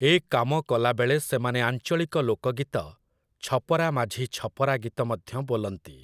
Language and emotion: Odia, neutral